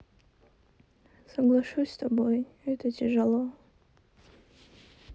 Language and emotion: Russian, sad